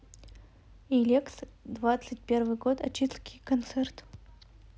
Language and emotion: Russian, neutral